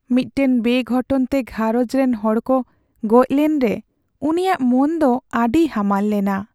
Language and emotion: Santali, sad